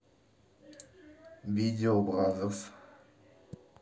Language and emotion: Russian, neutral